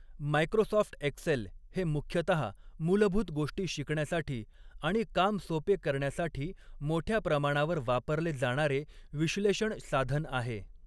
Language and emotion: Marathi, neutral